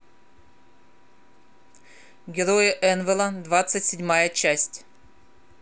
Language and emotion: Russian, neutral